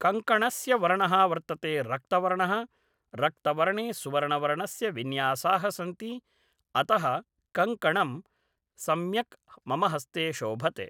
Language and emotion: Sanskrit, neutral